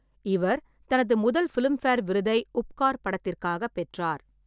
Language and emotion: Tamil, neutral